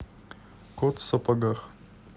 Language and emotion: Russian, neutral